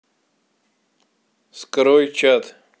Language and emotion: Russian, neutral